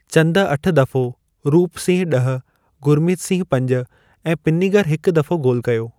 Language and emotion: Sindhi, neutral